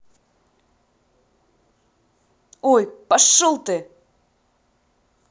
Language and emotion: Russian, angry